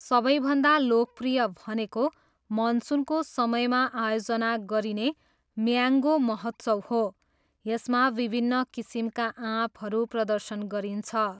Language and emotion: Nepali, neutral